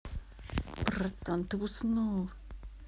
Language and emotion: Russian, angry